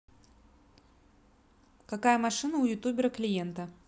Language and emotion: Russian, neutral